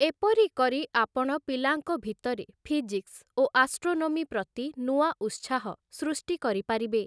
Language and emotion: Odia, neutral